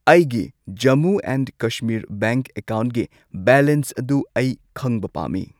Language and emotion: Manipuri, neutral